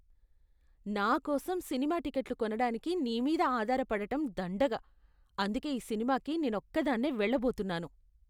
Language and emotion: Telugu, disgusted